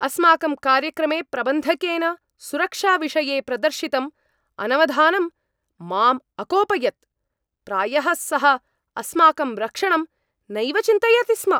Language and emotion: Sanskrit, angry